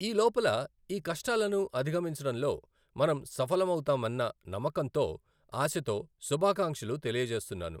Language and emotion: Telugu, neutral